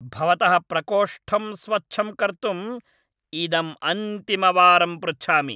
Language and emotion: Sanskrit, angry